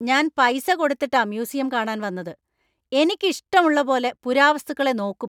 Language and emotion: Malayalam, angry